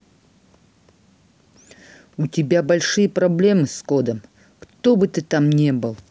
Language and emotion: Russian, angry